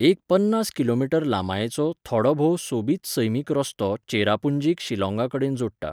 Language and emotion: Goan Konkani, neutral